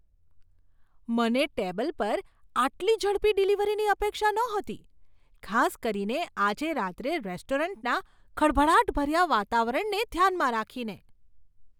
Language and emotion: Gujarati, surprised